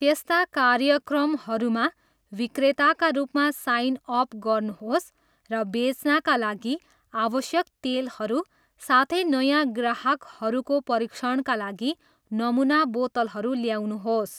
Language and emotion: Nepali, neutral